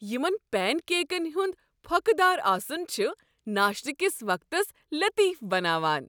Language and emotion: Kashmiri, happy